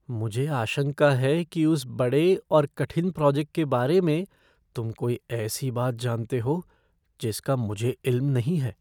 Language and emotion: Hindi, fearful